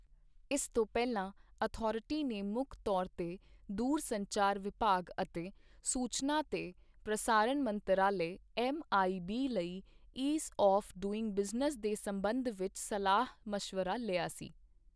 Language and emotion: Punjabi, neutral